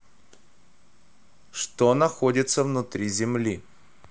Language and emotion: Russian, neutral